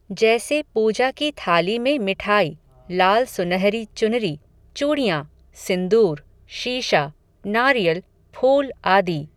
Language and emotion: Hindi, neutral